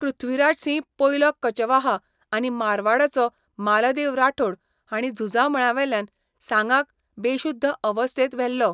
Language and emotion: Goan Konkani, neutral